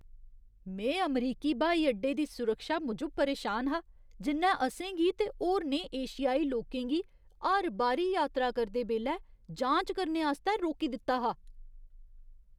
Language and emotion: Dogri, disgusted